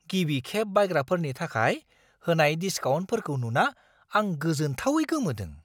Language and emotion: Bodo, surprised